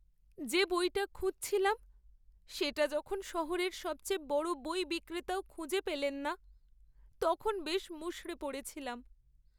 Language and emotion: Bengali, sad